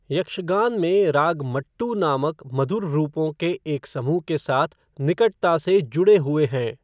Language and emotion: Hindi, neutral